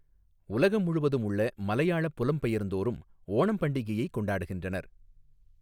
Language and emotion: Tamil, neutral